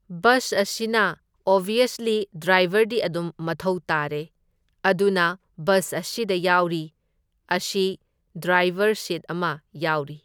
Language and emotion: Manipuri, neutral